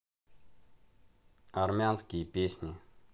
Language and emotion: Russian, neutral